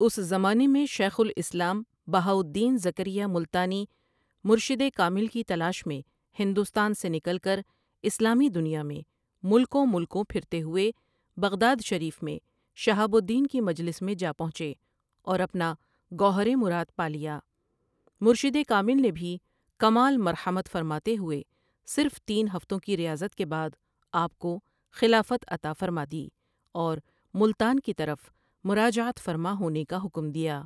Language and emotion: Urdu, neutral